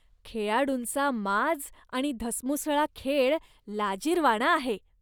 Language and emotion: Marathi, disgusted